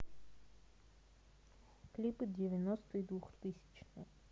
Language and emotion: Russian, neutral